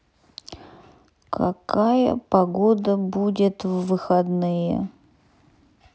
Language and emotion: Russian, sad